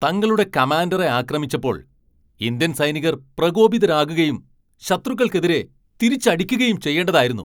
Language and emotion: Malayalam, angry